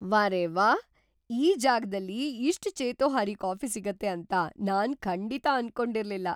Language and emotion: Kannada, surprised